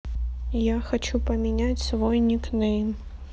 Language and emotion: Russian, neutral